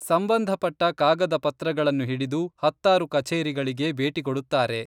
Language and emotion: Kannada, neutral